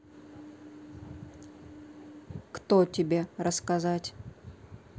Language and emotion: Russian, neutral